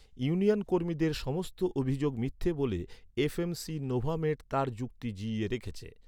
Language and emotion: Bengali, neutral